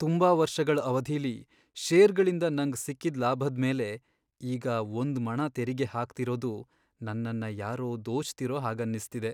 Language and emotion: Kannada, sad